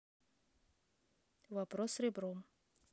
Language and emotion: Russian, neutral